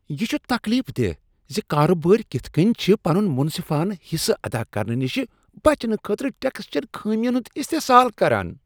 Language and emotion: Kashmiri, disgusted